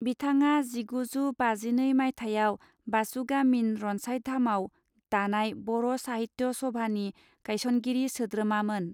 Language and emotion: Bodo, neutral